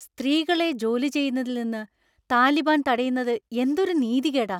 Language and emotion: Malayalam, angry